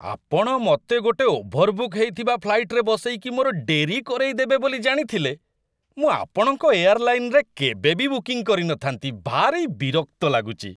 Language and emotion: Odia, disgusted